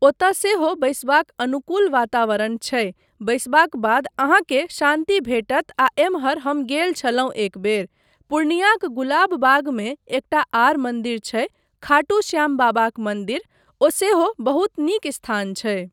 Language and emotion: Maithili, neutral